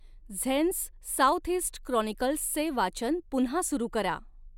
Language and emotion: Marathi, neutral